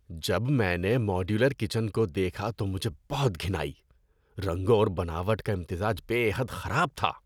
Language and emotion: Urdu, disgusted